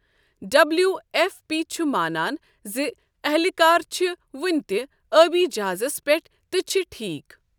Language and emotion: Kashmiri, neutral